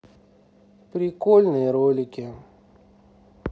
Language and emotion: Russian, neutral